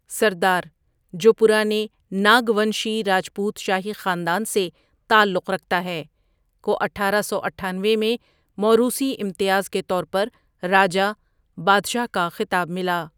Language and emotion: Urdu, neutral